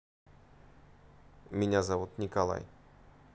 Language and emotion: Russian, neutral